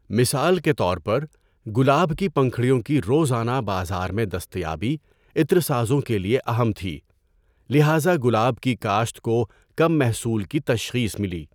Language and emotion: Urdu, neutral